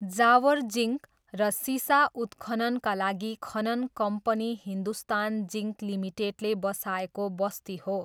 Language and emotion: Nepali, neutral